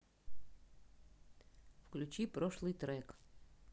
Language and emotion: Russian, neutral